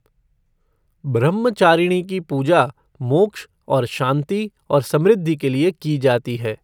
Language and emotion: Hindi, neutral